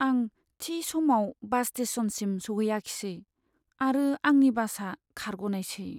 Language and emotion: Bodo, sad